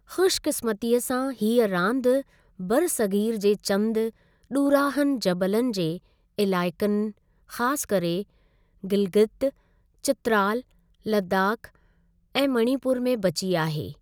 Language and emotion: Sindhi, neutral